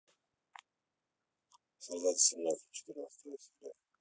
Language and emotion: Russian, neutral